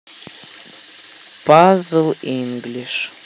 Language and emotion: Russian, neutral